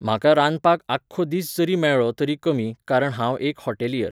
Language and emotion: Goan Konkani, neutral